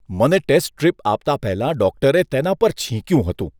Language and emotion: Gujarati, disgusted